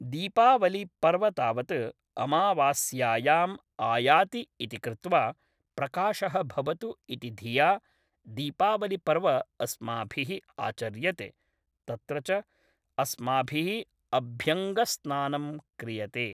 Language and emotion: Sanskrit, neutral